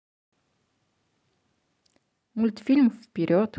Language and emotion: Russian, neutral